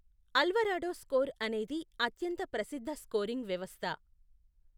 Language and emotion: Telugu, neutral